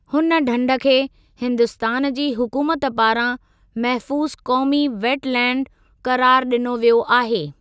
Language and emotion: Sindhi, neutral